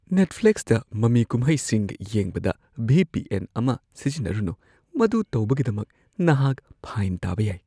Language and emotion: Manipuri, fearful